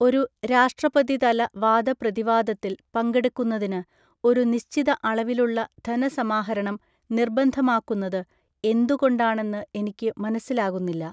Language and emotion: Malayalam, neutral